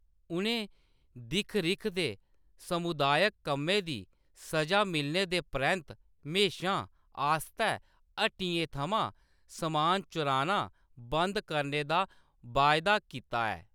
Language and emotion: Dogri, neutral